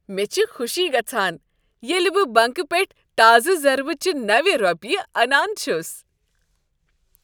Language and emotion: Kashmiri, happy